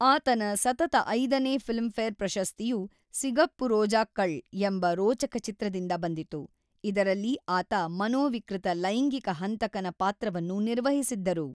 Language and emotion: Kannada, neutral